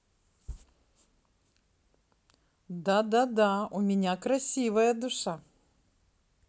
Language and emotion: Russian, positive